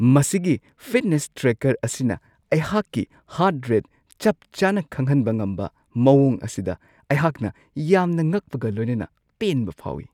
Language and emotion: Manipuri, surprised